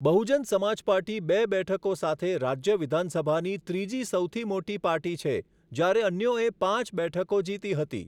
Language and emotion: Gujarati, neutral